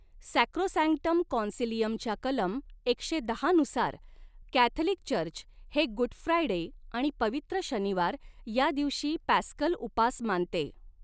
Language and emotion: Marathi, neutral